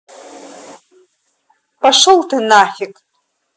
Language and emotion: Russian, angry